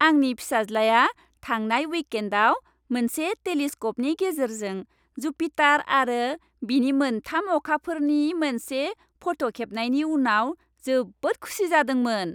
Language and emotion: Bodo, happy